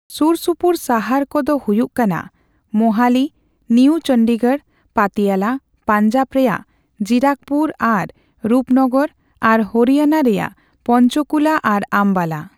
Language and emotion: Santali, neutral